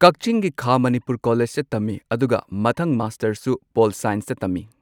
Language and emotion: Manipuri, neutral